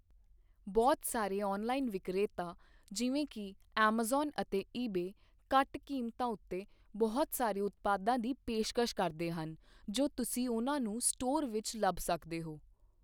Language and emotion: Punjabi, neutral